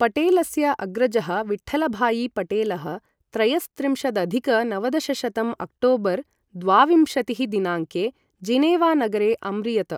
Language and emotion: Sanskrit, neutral